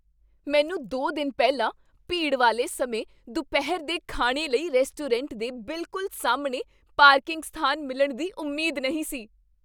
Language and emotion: Punjabi, surprised